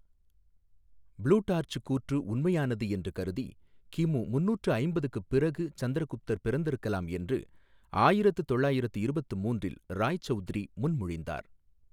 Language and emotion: Tamil, neutral